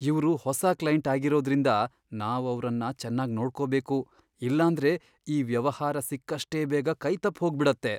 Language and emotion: Kannada, fearful